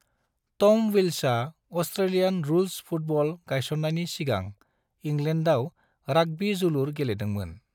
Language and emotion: Bodo, neutral